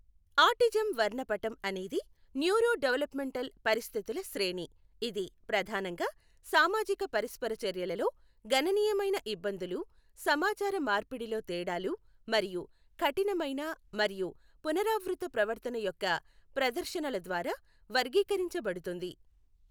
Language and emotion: Telugu, neutral